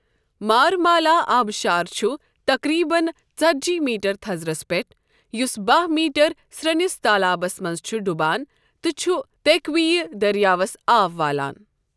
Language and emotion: Kashmiri, neutral